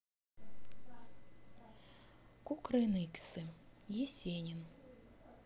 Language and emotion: Russian, neutral